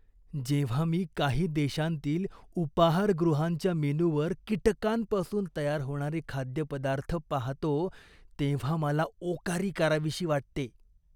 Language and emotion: Marathi, disgusted